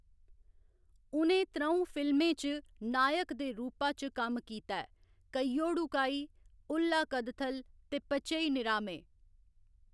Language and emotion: Dogri, neutral